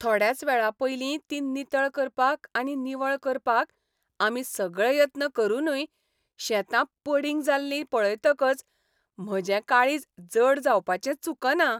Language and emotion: Goan Konkani, happy